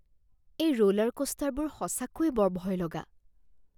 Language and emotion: Assamese, fearful